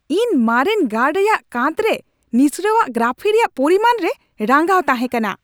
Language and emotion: Santali, angry